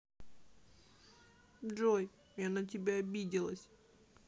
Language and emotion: Russian, sad